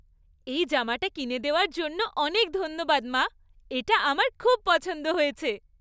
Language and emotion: Bengali, happy